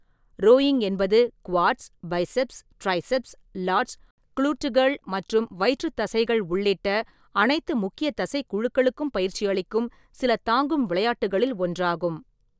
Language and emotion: Tamil, neutral